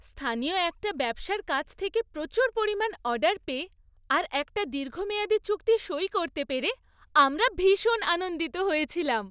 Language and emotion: Bengali, happy